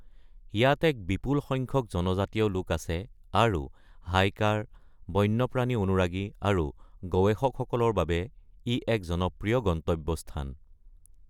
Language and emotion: Assamese, neutral